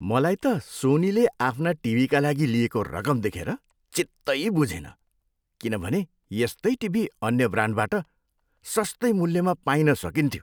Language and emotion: Nepali, disgusted